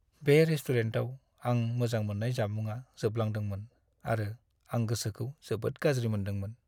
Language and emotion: Bodo, sad